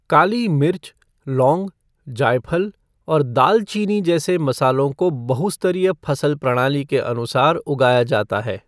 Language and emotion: Hindi, neutral